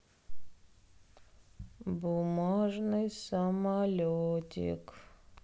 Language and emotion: Russian, sad